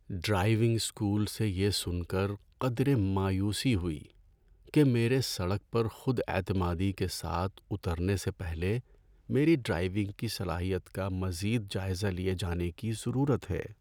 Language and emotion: Urdu, sad